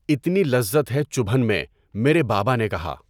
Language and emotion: Urdu, neutral